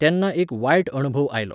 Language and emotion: Goan Konkani, neutral